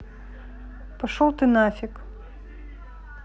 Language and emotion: Russian, neutral